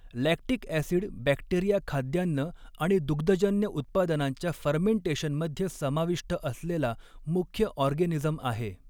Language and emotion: Marathi, neutral